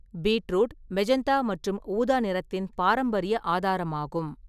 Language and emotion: Tamil, neutral